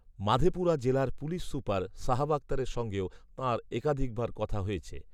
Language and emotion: Bengali, neutral